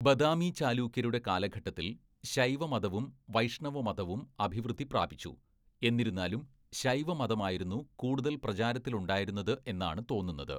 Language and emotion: Malayalam, neutral